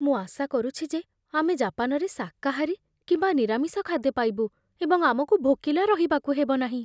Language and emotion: Odia, fearful